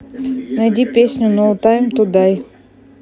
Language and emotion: Russian, neutral